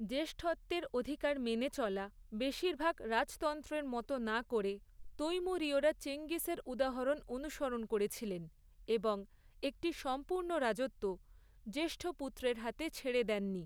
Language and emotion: Bengali, neutral